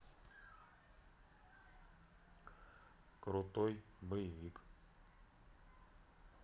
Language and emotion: Russian, neutral